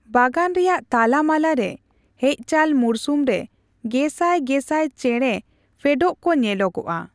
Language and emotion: Santali, neutral